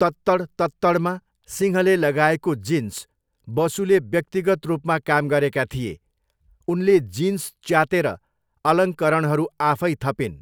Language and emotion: Nepali, neutral